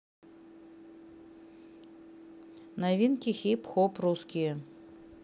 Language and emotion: Russian, neutral